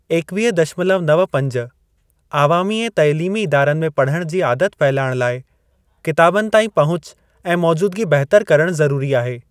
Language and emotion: Sindhi, neutral